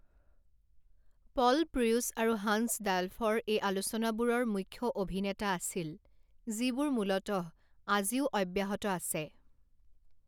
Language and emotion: Assamese, neutral